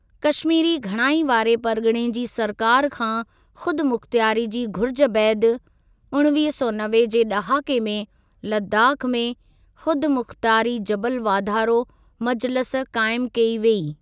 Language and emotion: Sindhi, neutral